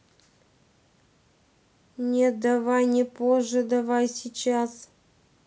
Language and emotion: Russian, neutral